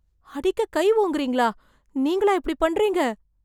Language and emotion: Tamil, surprised